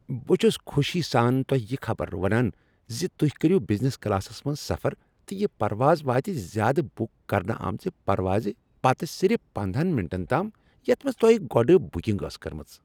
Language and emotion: Kashmiri, happy